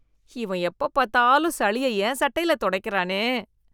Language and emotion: Tamil, disgusted